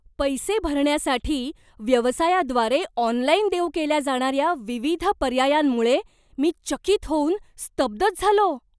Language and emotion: Marathi, surprised